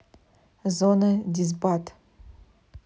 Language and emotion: Russian, neutral